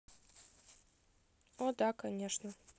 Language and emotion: Russian, neutral